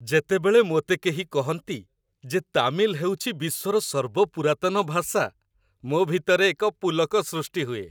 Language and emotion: Odia, happy